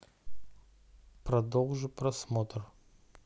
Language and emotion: Russian, neutral